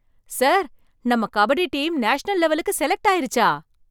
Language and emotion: Tamil, surprised